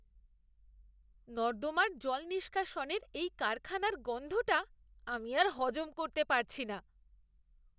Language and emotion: Bengali, disgusted